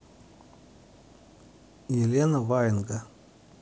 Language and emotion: Russian, neutral